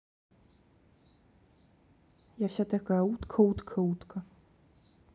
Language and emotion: Russian, neutral